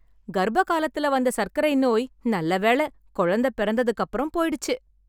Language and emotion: Tamil, happy